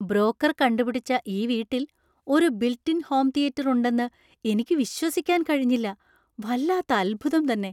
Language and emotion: Malayalam, surprised